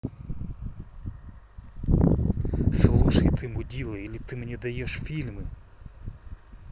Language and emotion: Russian, angry